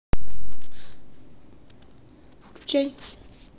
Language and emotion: Russian, neutral